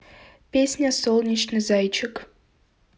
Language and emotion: Russian, neutral